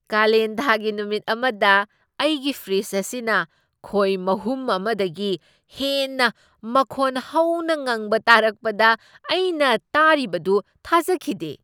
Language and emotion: Manipuri, surprised